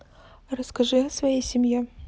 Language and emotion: Russian, neutral